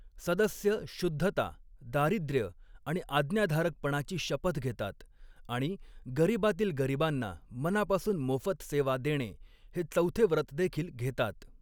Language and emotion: Marathi, neutral